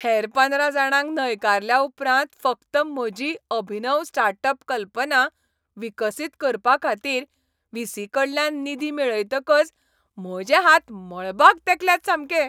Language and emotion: Goan Konkani, happy